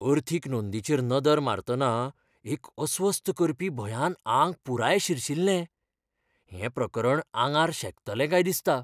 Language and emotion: Goan Konkani, fearful